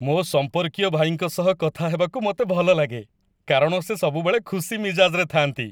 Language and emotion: Odia, happy